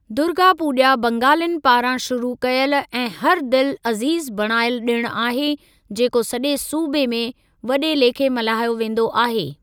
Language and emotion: Sindhi, neutral